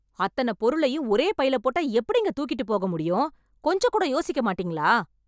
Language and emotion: Tamil, angry